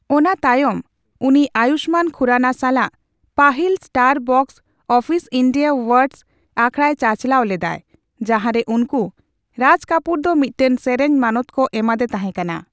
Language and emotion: Santali, neutral